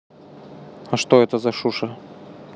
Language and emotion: Russian, neutral